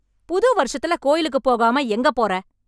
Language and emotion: Tamil, angry